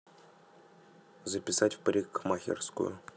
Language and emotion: Russian, neutral